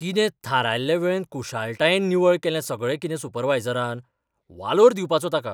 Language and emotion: Goan Konkani, surprised